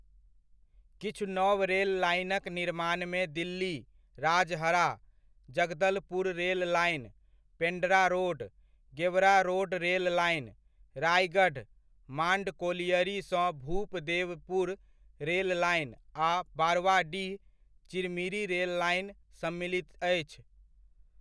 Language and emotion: Maithili, neutral